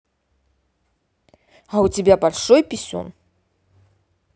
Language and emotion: Russian, angry